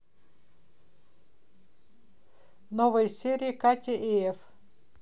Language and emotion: Russian, neutral